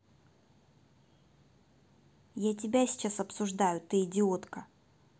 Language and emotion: Russian, angry